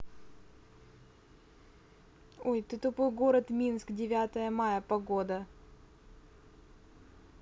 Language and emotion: Russian, neutral